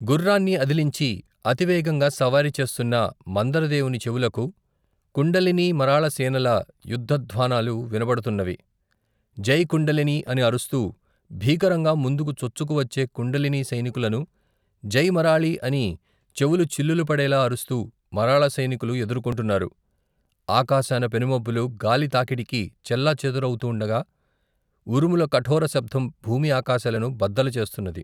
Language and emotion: Telugu, neutral